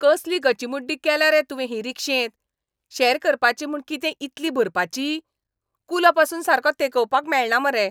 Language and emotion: Goan Konkani, angry